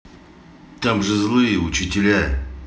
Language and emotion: Russian, angry